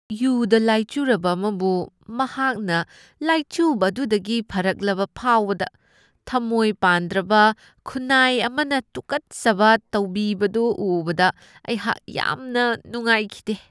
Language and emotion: Manipuri, disgusted